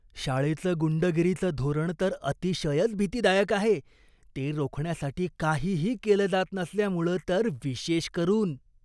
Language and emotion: Marathi, disgusted